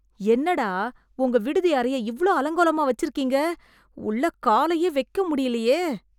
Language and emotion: Tamil, disgusted